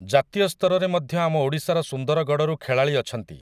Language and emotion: Odia, neutral